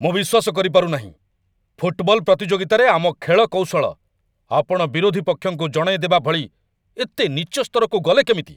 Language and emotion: Odia, angry